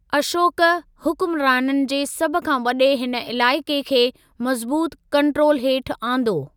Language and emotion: Sindhi, neutral